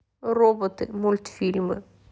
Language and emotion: Russian, neutral